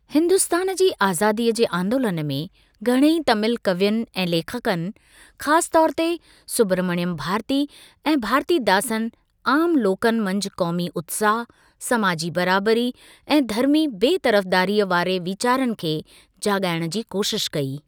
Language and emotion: Sindhi, neutral